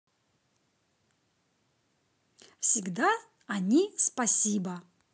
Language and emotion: Russian, positive